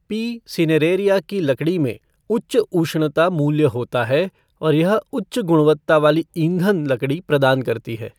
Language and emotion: Hindi, neutral